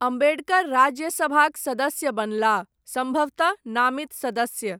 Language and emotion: Maithili, neutral